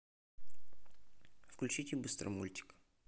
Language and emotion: Russian, neutral